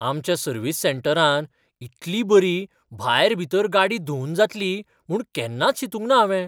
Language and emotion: Goan Konkani, surprised